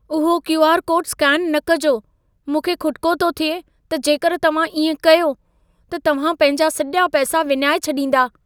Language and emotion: Sindhi, fearful